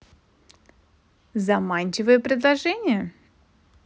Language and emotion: Russian, positive